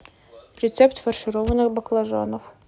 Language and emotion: Russian, neutral